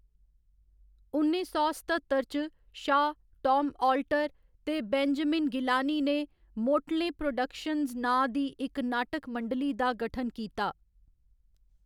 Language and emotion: Dogri, neutral